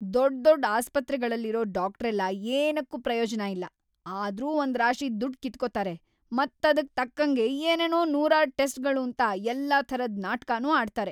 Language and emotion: Kannada, angry